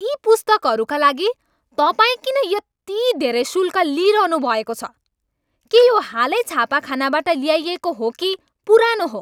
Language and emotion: Nepali, angry